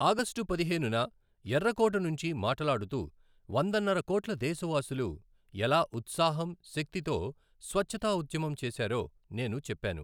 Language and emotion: Telugu, neutral